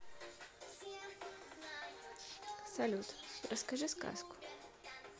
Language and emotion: Russian, neutral